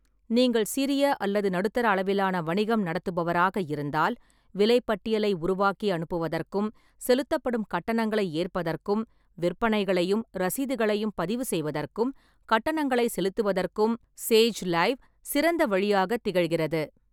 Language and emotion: Tamil, neutral